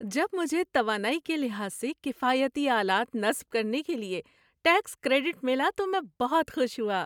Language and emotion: Urdu, happy